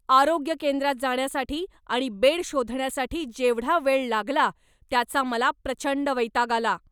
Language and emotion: Marathi, angry